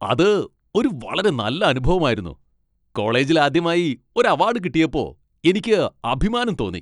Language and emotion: Malayalam, happy